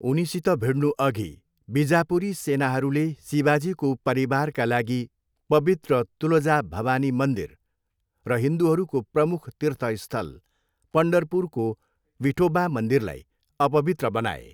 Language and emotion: Nepali, neutral